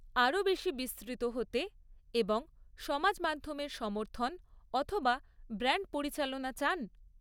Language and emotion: Bengali, neutral